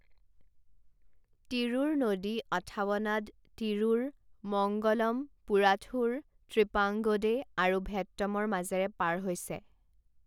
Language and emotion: Assamese, neutral